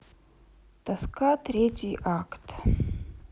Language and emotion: Russian, sad